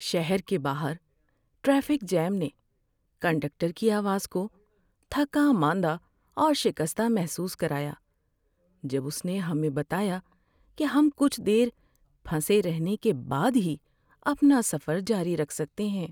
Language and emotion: Urdu, sad